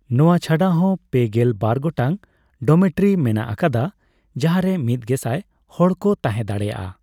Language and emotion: Santali, neutral